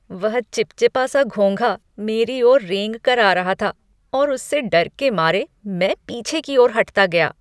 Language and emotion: Hindi, disgusted